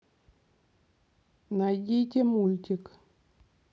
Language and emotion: Russian, neutral